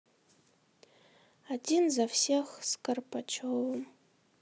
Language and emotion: Russian, sad